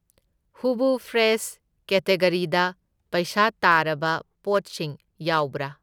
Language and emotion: Manipuri, neutral